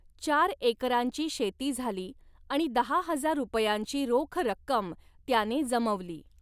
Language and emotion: Marathi, neutral